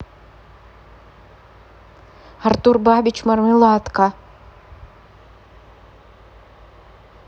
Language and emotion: Russian, neutral